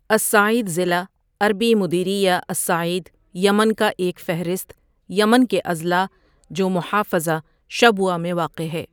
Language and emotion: Urdu, neutral